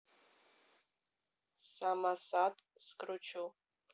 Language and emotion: Russian, neutral